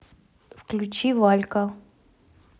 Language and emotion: Russian, neutral